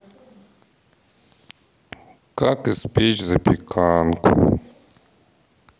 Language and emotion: Russian, sad